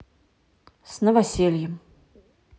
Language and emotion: Russian, neutral